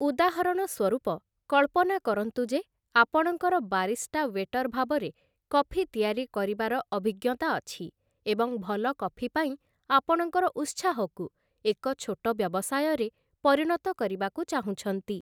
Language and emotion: Odia, neutral